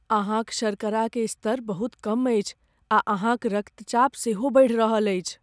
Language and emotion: Maithili, fearful